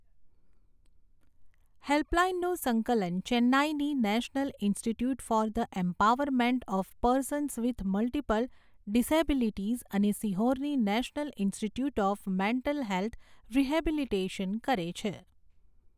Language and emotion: Gujarati, neutral